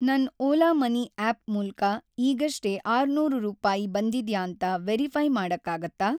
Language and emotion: Kannada, neutral